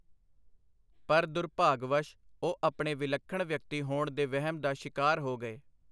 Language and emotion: Punjabi, neutral